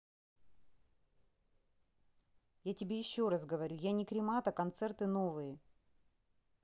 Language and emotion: Russian, angry